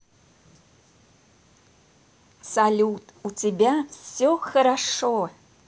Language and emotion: Russian, positive